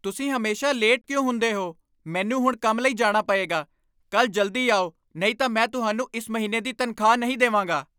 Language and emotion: Punjabi, angry